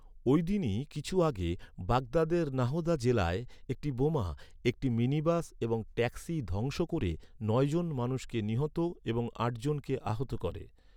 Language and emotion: Bengali, neutral